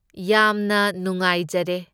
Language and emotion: Manipuri, neutral